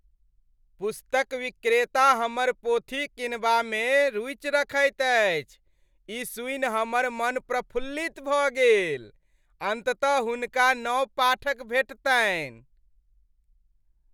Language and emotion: Maithili, happy